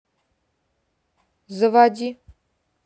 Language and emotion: Russian, neutral